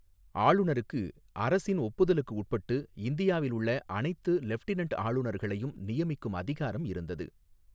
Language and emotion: Tamil, neutral